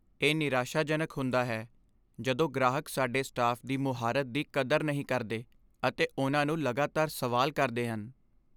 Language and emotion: Punjabi, sad